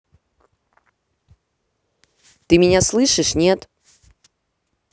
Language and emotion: Russian, angry